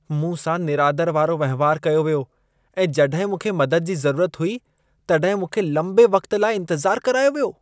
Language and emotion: Sindhi, disgusted